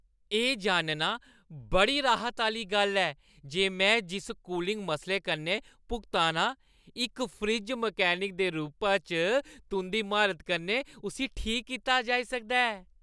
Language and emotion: Dogri, happy